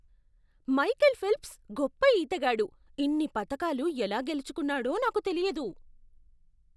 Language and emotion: Telugu, surprised